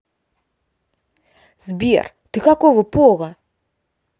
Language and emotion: Russian, neutral